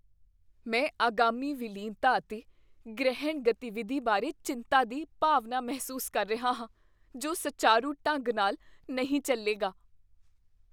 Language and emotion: Punjabi, fearful